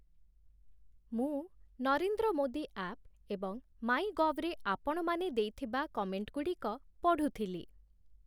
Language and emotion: Odia, neutral